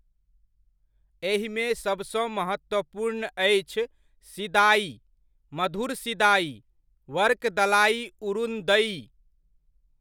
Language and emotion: Maithili, neutral